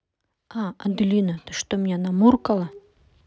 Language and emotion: Russian, neutral